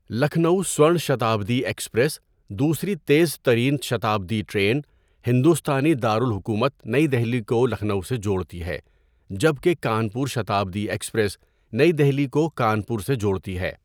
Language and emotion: Urdu, neutral